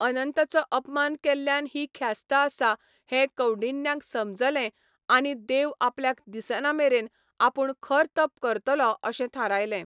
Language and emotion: Goan Konkani, neutral